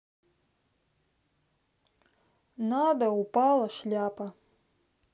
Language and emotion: Russian, sad